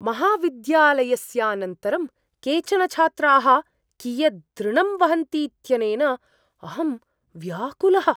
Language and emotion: Sanskrit, surprised